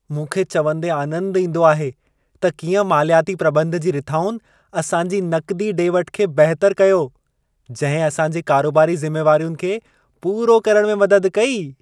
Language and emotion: Sindhi, happy